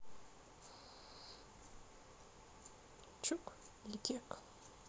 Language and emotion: Russian, neutral